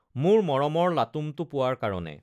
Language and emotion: Assamese, neutral